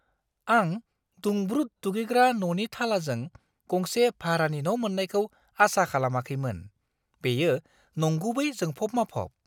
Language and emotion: Bodo, surprised